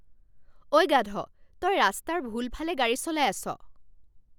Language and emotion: Assamese, angry